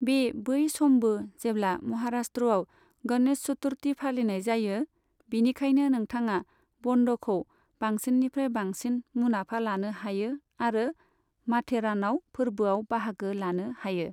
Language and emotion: Bodo, neutral